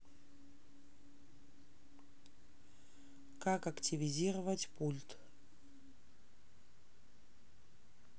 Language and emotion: Russian, neutral